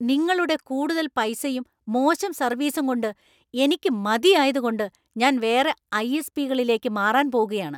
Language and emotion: Malayalam, angry